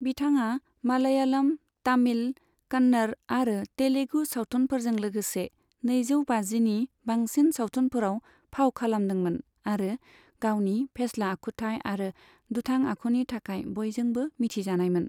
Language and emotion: Bodo, neutral